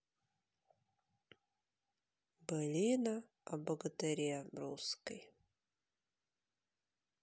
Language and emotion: Russian, sad